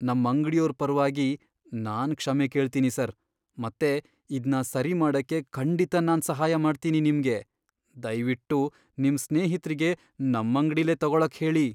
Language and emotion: Kannada, fearful